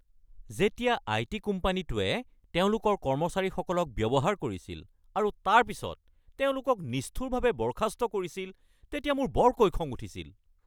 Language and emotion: Assamese, angry